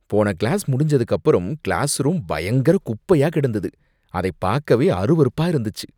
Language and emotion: Tamil, disgusted